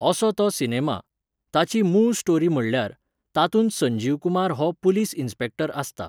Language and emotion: Goan Konkani, neutral